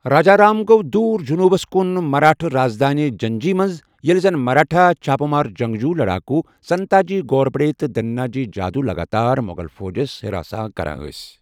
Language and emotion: Kashmiri, neutral